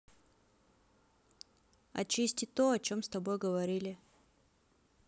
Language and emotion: Russian, neutral